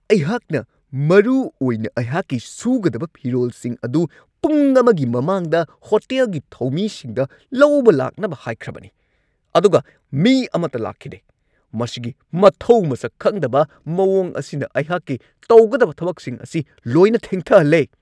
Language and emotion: Manipuri, angry